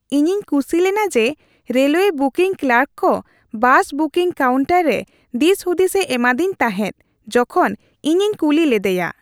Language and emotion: Santali, happy